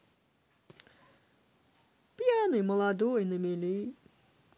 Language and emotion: Russian, positive